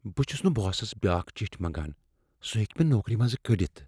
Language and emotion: Kashmiri, fearful